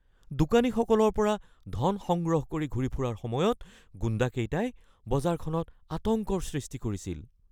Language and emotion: Assamese, fearful